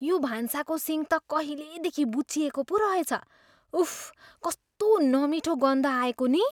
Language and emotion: Nepali, disgusted